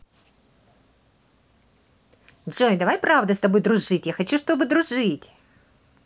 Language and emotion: Russian, positive